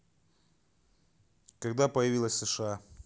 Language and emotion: Russian, neutral